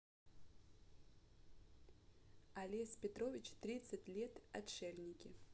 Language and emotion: Russian, neutral